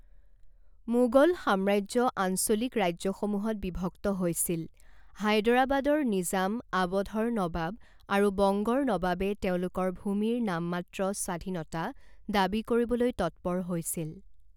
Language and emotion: Assamese, neutral